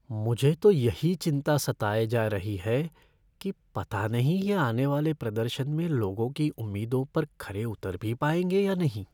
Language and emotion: Hindi, fearful